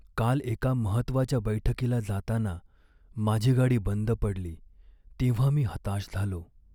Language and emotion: Marathi, sad